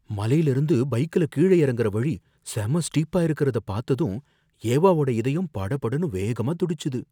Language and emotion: Tamil, fearful